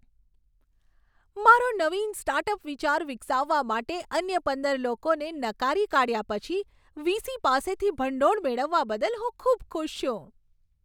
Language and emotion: Gujarati, happy